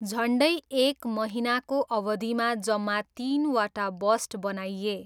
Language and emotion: Nepali, neutral